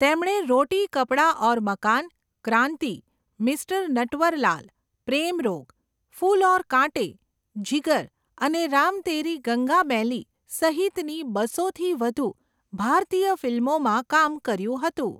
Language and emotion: Gujarati, neutral